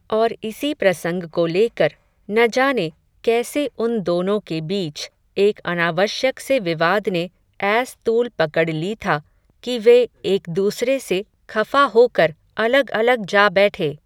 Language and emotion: Hindi, neutral